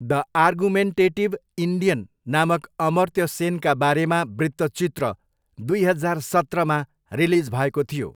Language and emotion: Nepali, neutral